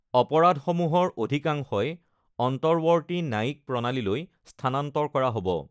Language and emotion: Assamese, neutral